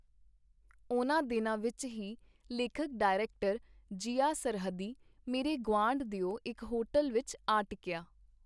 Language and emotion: Punjabi, neutral